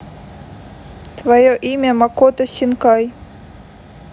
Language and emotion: Russian, neutral